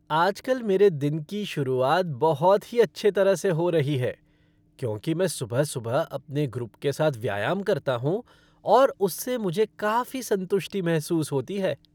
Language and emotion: Hindi, happy